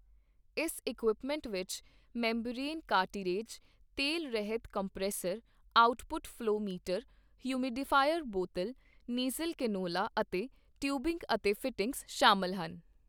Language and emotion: Punjabi, neutral